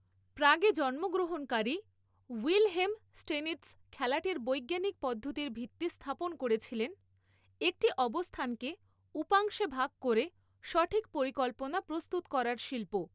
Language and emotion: Bengali, neutral